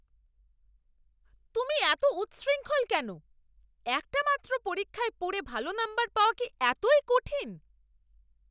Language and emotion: Bengali, angry